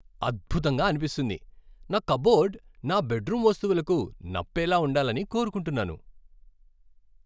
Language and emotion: Telugu, happy